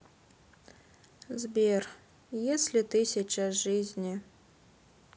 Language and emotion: Russian, sad